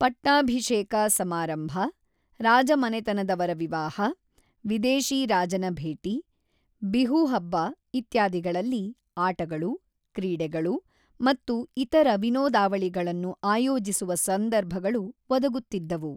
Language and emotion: Kannada, neutral